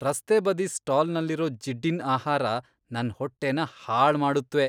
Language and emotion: Kannada, disgusted